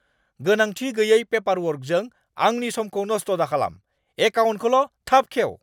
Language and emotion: Bodo, angry